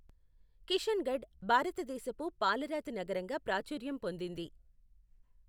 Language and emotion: Telugu, neutral